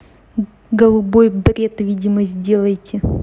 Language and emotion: Russian, angry